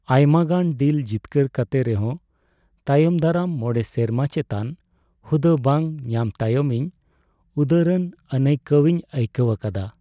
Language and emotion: Santali, sad